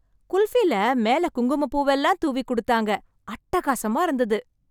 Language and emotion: Tamil, happy